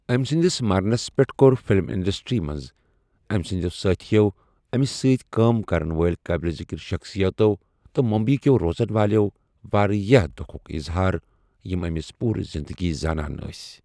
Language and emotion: Kashmiri, neutral